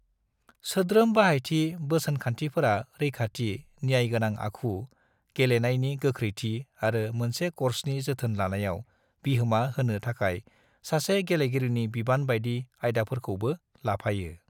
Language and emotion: Bodo, neutral